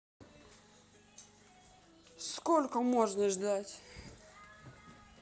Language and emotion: Russian, angry